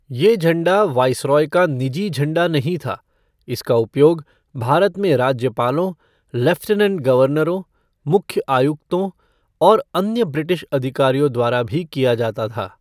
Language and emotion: Hindi, neutral